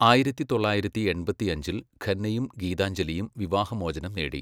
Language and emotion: Malayalam, neutral